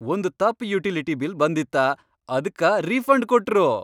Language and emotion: Kannada, happy